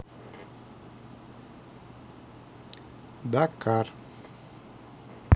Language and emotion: Russian, neutral